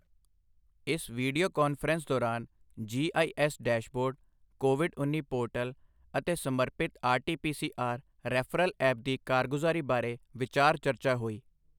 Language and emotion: Punjabi, neutral